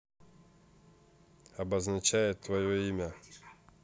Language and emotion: Russian, neutral